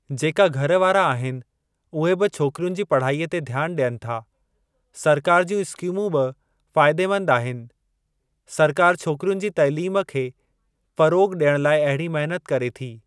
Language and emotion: Sindhi, neutral